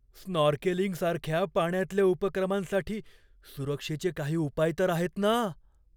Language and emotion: Marathi, fearful